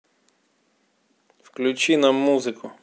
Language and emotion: Russian, neutral